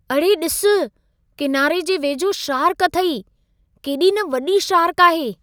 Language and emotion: Sindhi, surprised